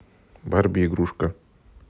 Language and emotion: Russian, neutral